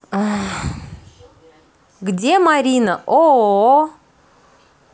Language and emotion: Russian, positive